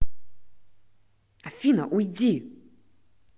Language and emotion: Russian, angry